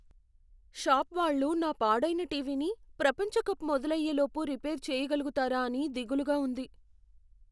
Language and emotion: Telugu, fearful